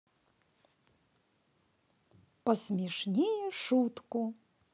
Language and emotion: Russian, positive